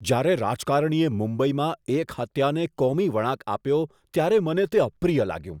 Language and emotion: Gujarati, disgusted